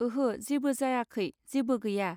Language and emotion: Bodo, neutral